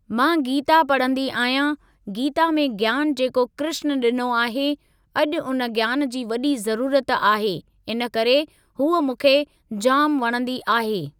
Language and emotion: Sindhi, neutral